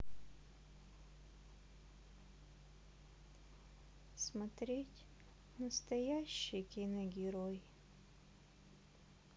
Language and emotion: Russian, sad